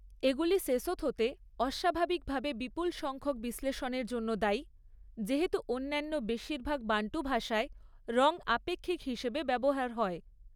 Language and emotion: Bengali, neutral